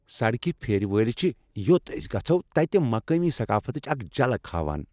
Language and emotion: Kashmiri, happy